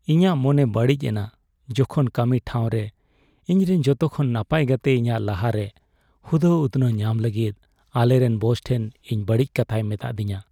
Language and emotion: Santali, sad